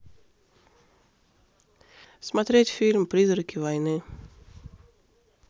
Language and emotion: Russian, neutral